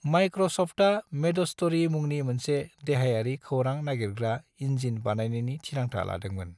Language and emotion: Bodo, neutral